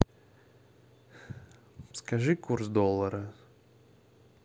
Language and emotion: Russian, neutral